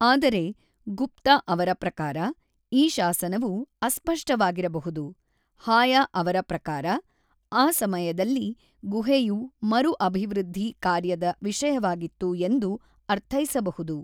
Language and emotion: Kannada, neutral